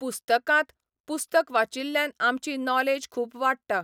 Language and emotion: Goan Konkani, neutral